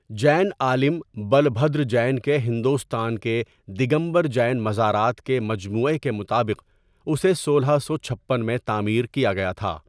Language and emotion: Urdu, neutral